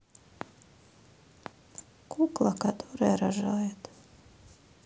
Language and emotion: Russian, sad